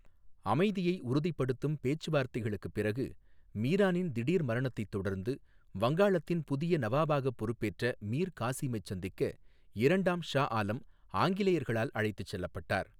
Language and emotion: Tamil, neutral